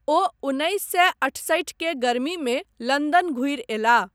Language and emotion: Maithili, neutral